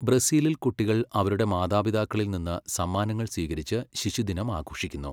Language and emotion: Malayalam, neutral